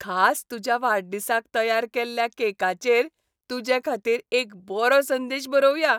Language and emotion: Goan Konkani, happy